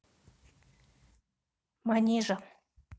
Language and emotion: Russian, neutral